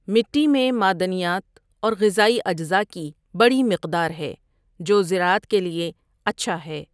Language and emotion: Urdu, neutral